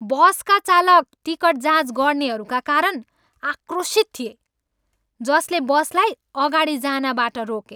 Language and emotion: Nepali, angry